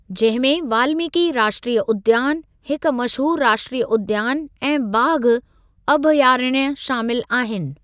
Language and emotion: Sindhi, neutral